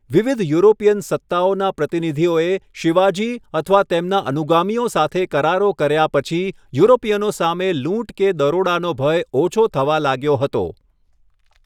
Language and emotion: Gujarati, neutral